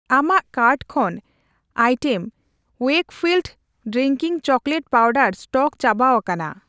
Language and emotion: Santali, neutral